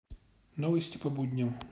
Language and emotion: Russian, neutral